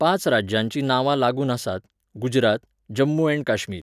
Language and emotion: Goan Konkani, neutral